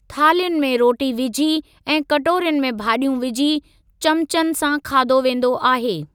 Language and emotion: Sindhi, neutral